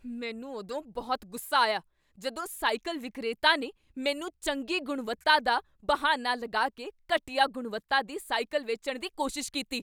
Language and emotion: Punjabi, angry